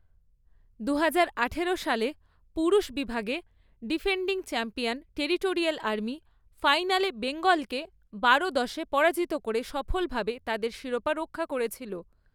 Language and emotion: Bengali, neutral